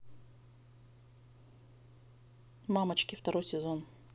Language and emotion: Russian, neutral